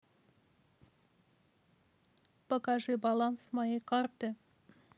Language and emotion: Russian, neutral